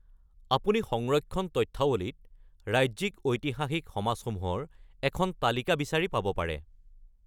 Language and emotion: Assamese, neutral